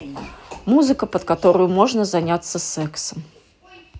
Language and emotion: Russian, neutral